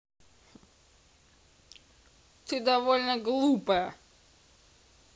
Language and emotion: Russian, angry